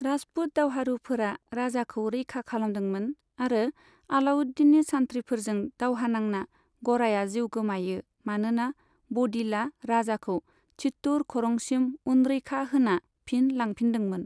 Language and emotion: Bodo, neutral